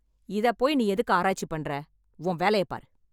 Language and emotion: Tamil, angry